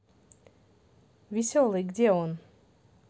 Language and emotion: Russian, positive